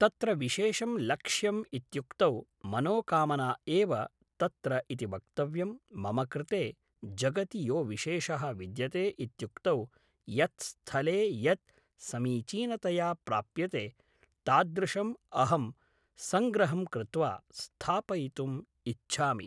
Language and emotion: Sanskrit, neutral